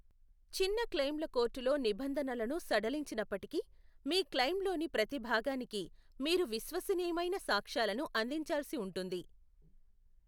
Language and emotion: Telugu, neutral